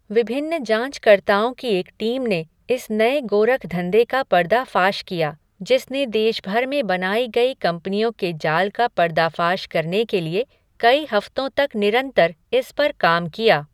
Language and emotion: Hindi, neutral